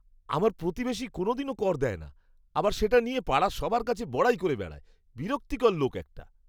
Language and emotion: Bengali, disgusted